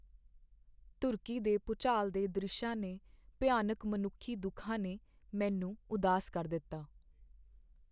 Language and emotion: Punjabi, sad